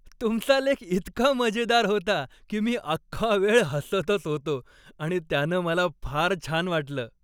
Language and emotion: Marathi, happy